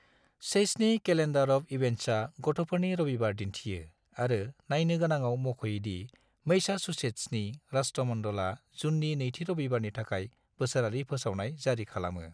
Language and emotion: Bodo, neutral